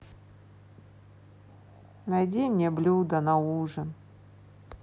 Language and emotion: Russian, sad